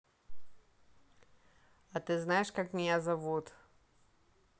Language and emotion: Russian, neutral